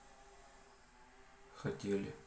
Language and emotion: Russian, neutral